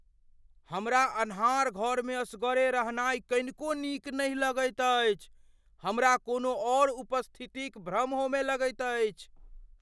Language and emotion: Maithili, fearful